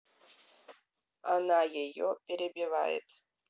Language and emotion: Russian, neutral